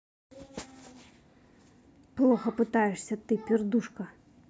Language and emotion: Russian, angry